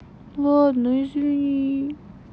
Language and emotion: Russian, sad